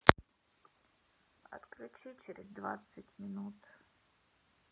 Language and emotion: Russian, sad